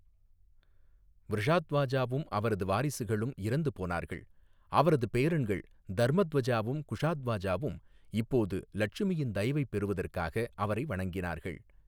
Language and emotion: Tamil, neutral